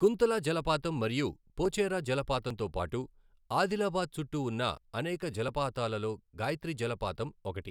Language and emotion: Telugu, neutral